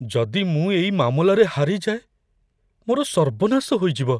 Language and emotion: Odia, fearful